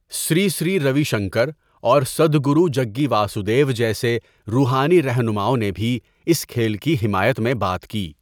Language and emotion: Urdu, neutral